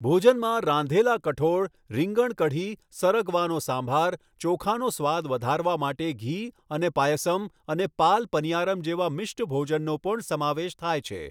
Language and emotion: Gujarati, neutral